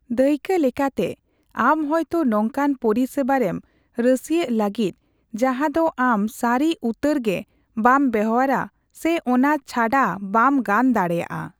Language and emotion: Santali, neutral